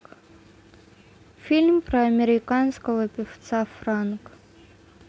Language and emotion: Russian, neutral